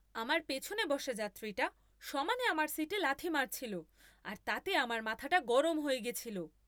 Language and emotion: Bengali, angry